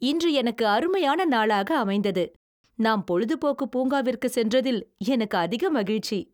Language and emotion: Tamil, happy